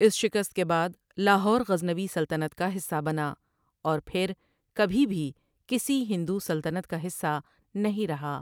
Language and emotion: Urdu, neutral